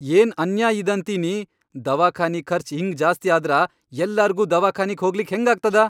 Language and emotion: Kannada, angry